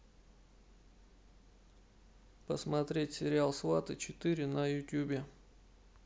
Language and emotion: Russian, neutral